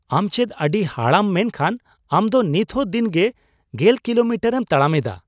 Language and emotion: Santali, surprised